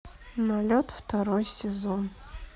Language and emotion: Russian, sad